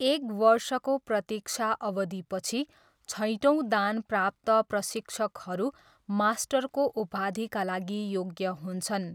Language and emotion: Nepali, neutral